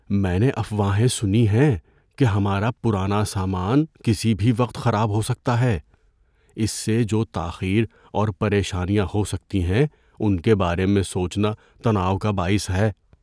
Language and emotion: Urdu, fearful